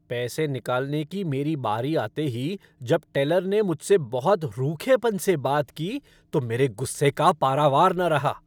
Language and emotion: Hindi, angry